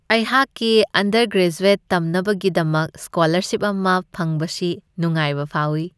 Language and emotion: Manipuri, happy